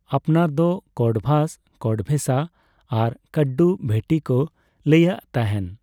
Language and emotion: Santali, neutral